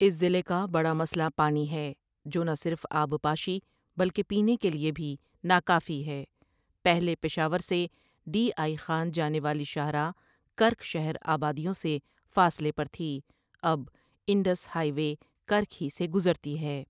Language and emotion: Urdu, neutral